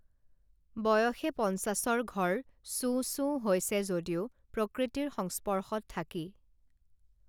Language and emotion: Assamese, neutral